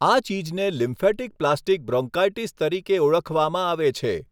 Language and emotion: Gujarati, neutral